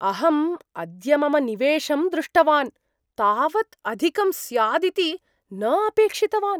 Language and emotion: Sanskrit, surprised